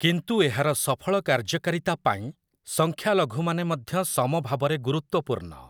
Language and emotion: Odia, neutral